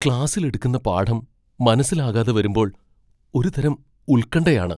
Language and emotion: Malayalam, fearful